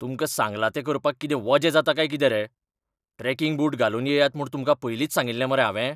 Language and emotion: Goan Konkani, angry